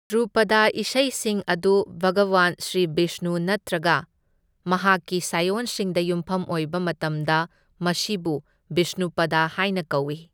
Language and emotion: Manipuri, neutral